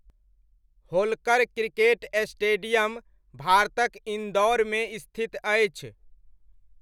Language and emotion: Maithili, neutral